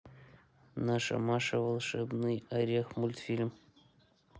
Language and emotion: Russian, neutral